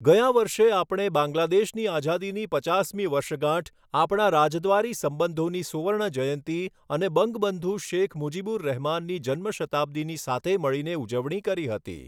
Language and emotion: Gujarati, neutral